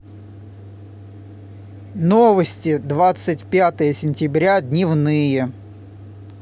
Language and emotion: Russian, positive